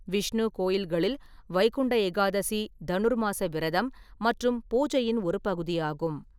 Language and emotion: Tamil, neutral